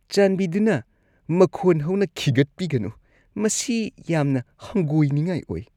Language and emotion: Manipuri, disgusted